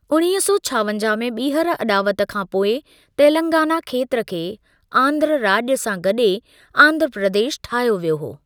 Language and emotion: Sindhi, neutral